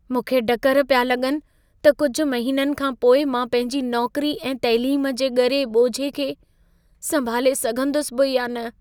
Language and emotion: Sindhi, fearful